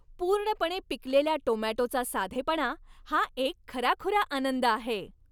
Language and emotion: Marathi, happy